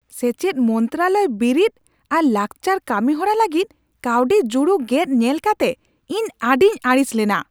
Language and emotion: Santali, angry